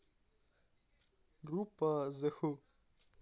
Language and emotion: Russian, neutral